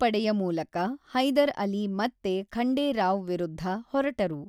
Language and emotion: Kannada, neutral